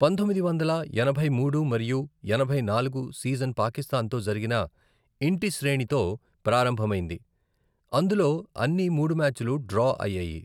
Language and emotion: Telugu, neutral